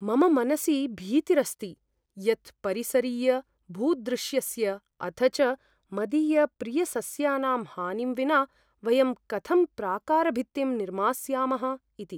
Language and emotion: Sanskrit, fearful